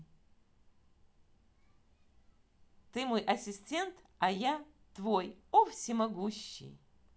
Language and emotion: Russian, positive